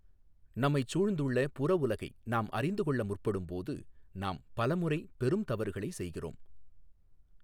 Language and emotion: Tamil, neutral